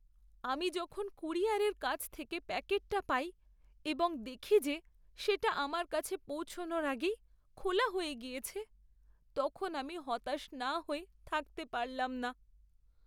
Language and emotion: Bengali, sad